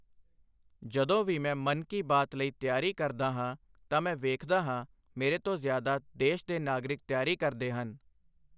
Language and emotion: Punjabi, neutral